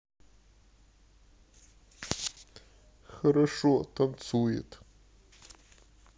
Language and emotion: Russian, sad